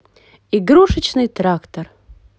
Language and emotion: Russian, positive